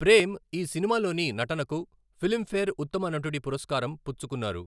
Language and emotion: Telugu, neutral